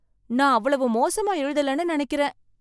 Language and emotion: Tamil, surprised